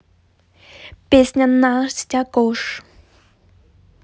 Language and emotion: Russian, positive